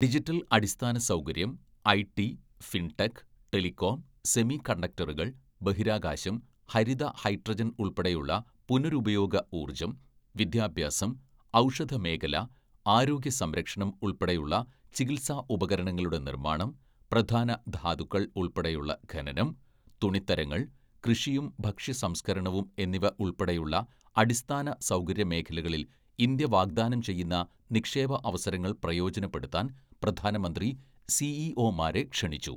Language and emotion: Malayalam, neutral